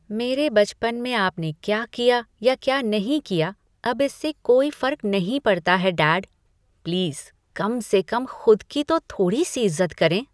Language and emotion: Hindi, disgusted